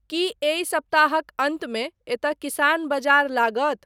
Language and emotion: Maithili, neutral